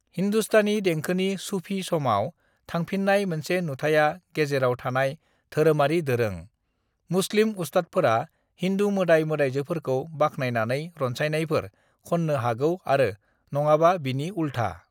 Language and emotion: Bodo, neutral